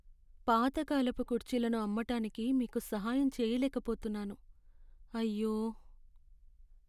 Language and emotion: Telugu, sad